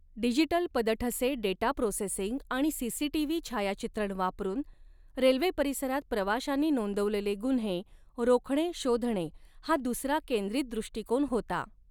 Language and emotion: Marathi, neutral